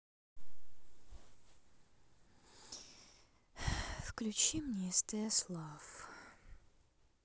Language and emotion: Russian, sad